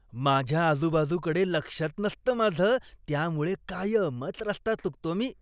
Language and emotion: Marathi, disgusted